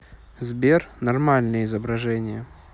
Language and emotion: Russian, neutral